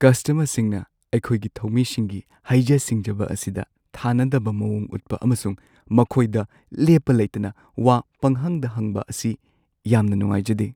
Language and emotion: Manipuri, sad